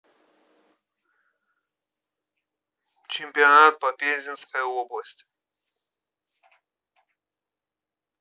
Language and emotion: Russian, neutral